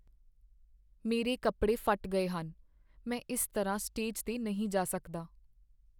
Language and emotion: Punjabi, sad